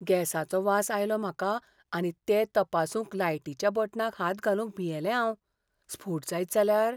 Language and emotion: Goan Konkani, fearful